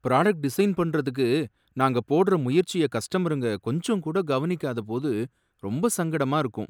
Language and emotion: Tamil, sad